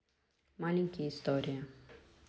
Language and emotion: Russian, neutral